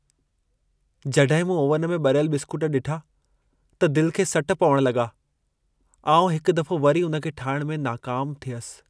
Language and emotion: Sindhi, sad